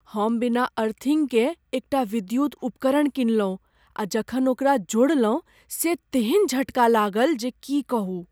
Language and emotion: Maithili, fearful